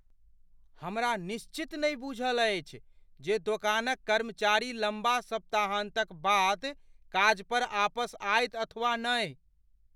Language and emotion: Maithili, fearful